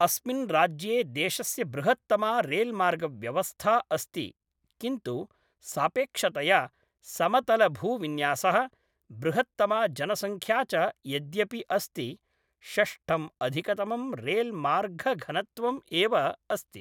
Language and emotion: Sanskrit, neutral